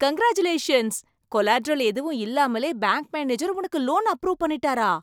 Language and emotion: Tamil, surprised